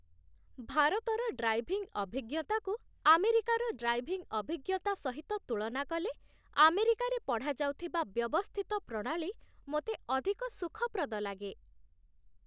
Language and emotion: Odia, happy